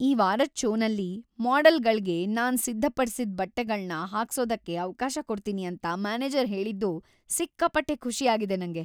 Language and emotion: Kannada, happy